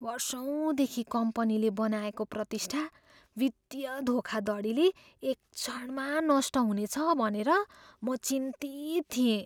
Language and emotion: Nepali, fearful